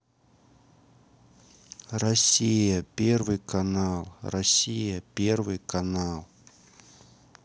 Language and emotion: Russian, sad